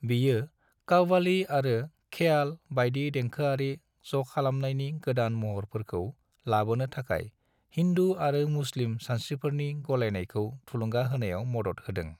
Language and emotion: Bodo, neutral